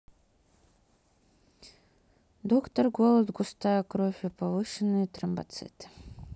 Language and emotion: Russian, neutral